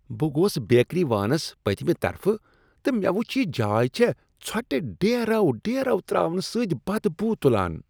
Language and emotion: Kashmiri, disgusted